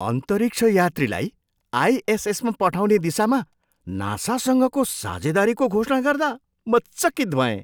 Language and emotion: Nepali, surprised